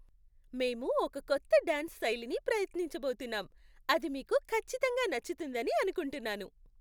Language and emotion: Telugu, happy